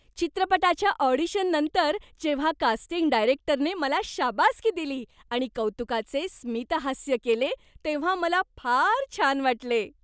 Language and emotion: Marathi, happy